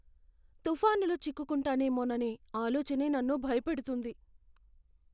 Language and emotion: Telugu, fearful